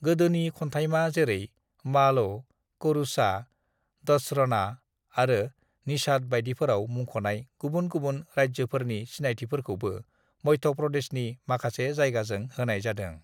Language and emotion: Bodo, neutral